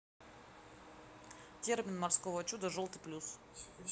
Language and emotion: Russian, neutral